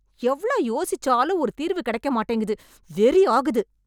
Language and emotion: Tamil, angry